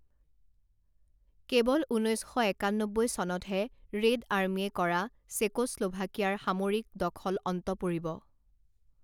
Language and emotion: Assamese, neutral